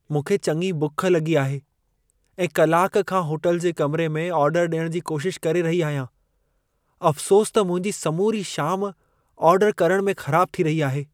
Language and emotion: Sindhi, sad